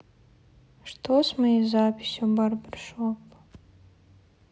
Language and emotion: Russian, sad